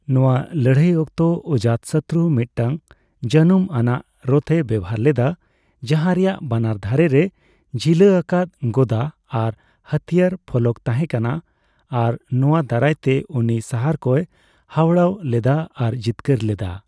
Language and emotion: Santali, neutral